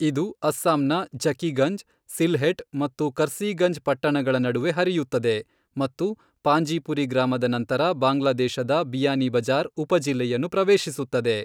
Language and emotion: Kannada, neutral